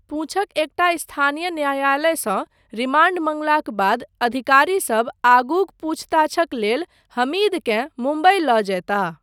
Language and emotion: Maithili, neutral